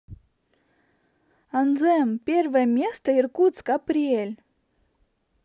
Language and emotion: Russian, positive